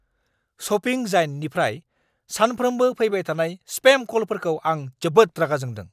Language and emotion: Bodo, angry